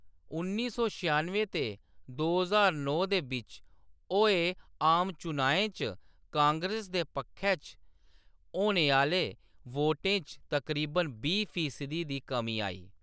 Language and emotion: Dogri, neutral